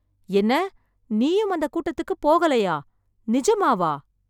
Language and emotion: Tamil, surprised